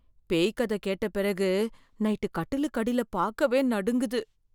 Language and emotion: Tamil, fearful